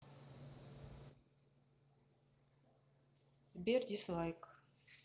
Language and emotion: Russian, neutral